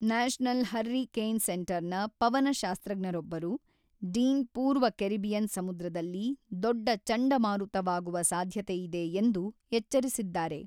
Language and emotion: Kannada, neutral